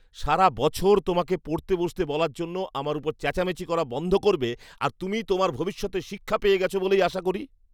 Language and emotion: Bengali, disgusted